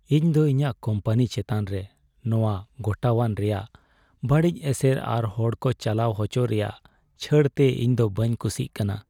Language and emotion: Santali, sad